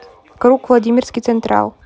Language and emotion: Russian, neutral